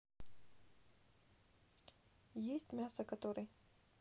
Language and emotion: Russian, neutral